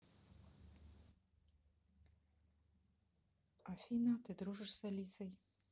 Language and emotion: Russian, neutral